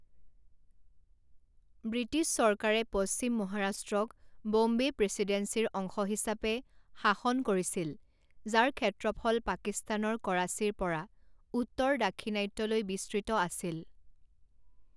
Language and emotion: Assamese, neutral